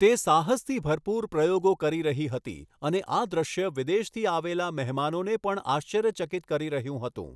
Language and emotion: Gujarati, neutral